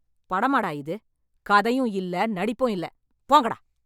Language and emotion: Tamil, angry